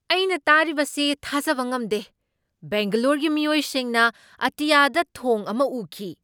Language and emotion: Manipuri, surprised